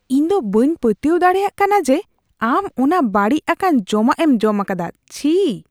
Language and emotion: Santali, disgusted